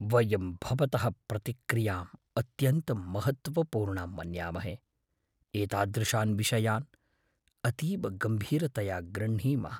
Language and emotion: Sanskrit, fearful